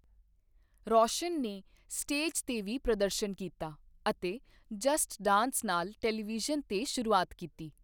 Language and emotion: Punjabi, neutral